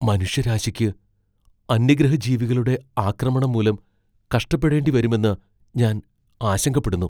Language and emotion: Malayalam, fearful